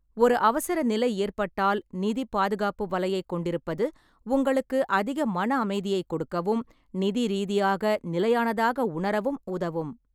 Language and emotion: Tamil, neutral